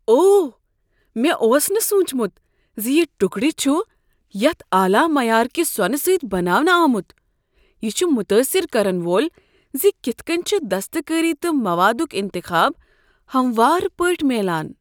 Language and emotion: Kashmiri, surprised